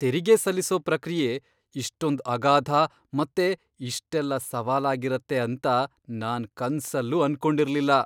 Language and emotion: Kannada, surprised